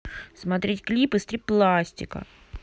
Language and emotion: Russian, neutral